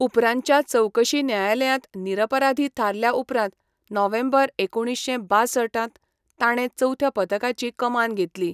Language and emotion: Goan Konkani, neutral